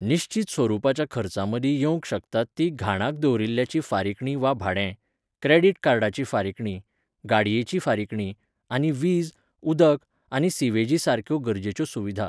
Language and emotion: Goan Konkani, neutral